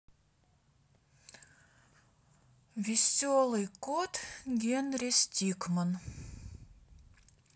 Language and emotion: Russian, neutral